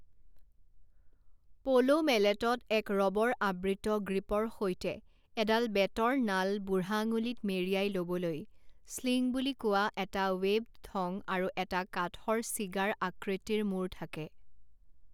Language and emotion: Assamese, neutral